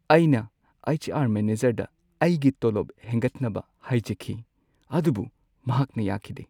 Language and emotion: Manipuri, sad